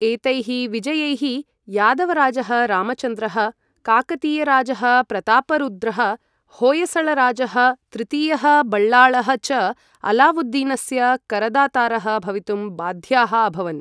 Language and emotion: Sanskrit, neutral